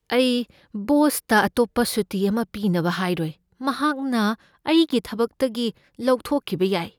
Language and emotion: Manipuri, fearful